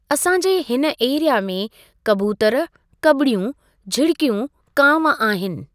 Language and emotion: Sindhi, neutral